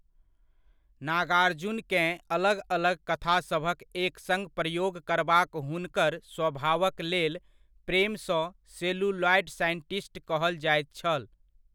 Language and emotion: Maithili, neutral